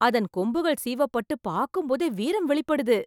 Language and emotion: Tamil, surprised